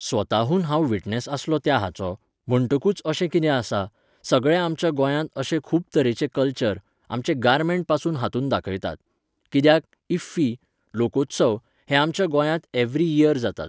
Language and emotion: Goan Konkani, neutral